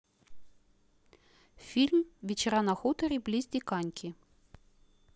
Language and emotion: Russian, neutral